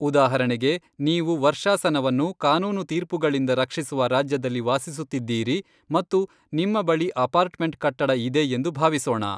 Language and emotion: Kannada, neutral